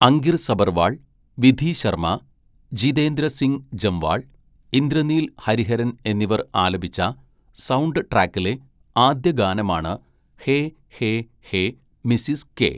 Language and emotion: Malayalam, neutral